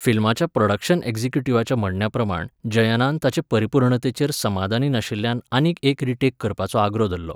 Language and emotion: Goan Konkani, neutral